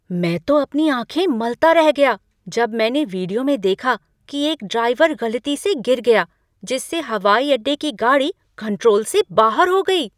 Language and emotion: Hindi, surprised